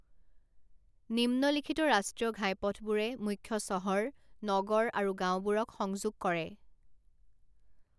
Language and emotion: Assamese, neutral